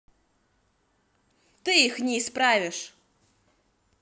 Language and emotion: Russian, angry